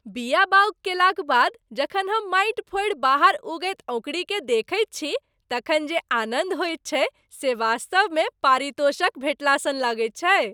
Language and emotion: Maithili, happy